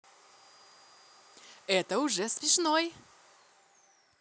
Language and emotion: Russian, positive